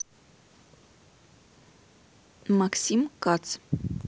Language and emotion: Russian, neutral